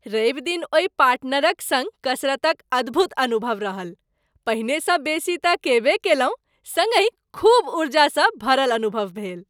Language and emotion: Maithili, happy